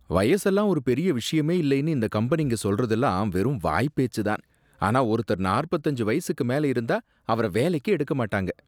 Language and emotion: Tamil, disgusted